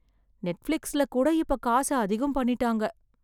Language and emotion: Tamil, sad